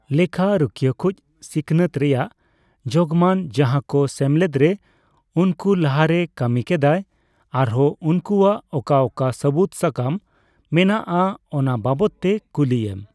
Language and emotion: Santali, neutral